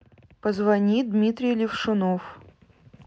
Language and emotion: Russian, neutral